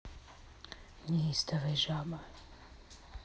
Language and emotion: Russian, neutral